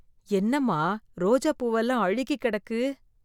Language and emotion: Tamil, disgusted